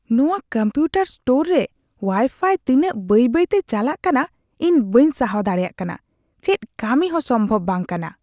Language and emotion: Santali, disgusted